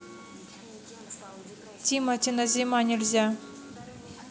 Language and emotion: Russian, neutral